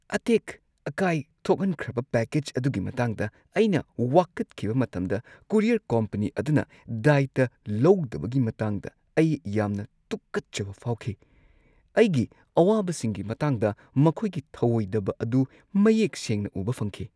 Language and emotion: Manipuri, disgusted